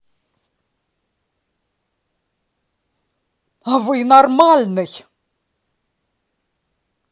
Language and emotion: Russian, angry